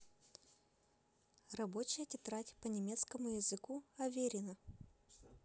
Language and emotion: Russian, positive